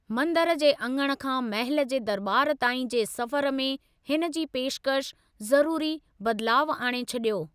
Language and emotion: Sindhi, neutral